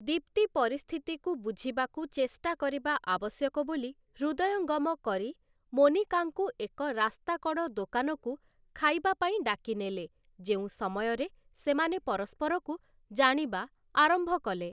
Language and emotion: Odia, neutral